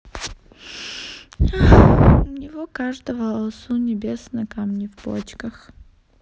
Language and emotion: Russian, sad